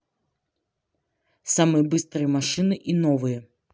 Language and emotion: Russian, neutral